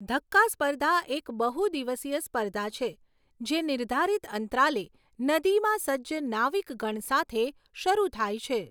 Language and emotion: Gujarati, neutral